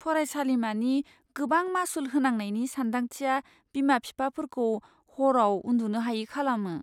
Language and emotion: Bodo, fearful